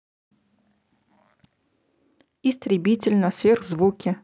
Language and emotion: Russian, neutral